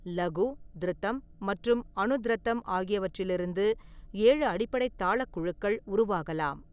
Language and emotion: Tamil, neutral